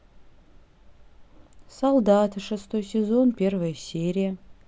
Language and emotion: Russian, neutral